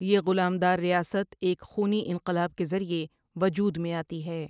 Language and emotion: Urdu, neutral